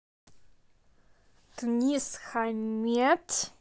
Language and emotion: Russian, neutral